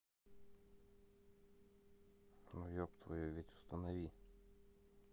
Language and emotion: Russian, neutral